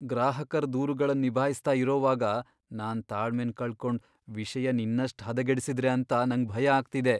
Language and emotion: Kannada, fearful